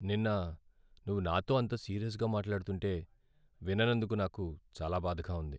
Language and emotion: Telugu, sad